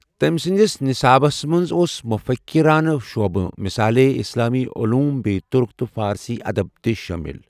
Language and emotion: Kashmiri, neutral